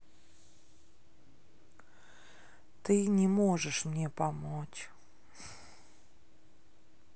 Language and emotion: Russian, sad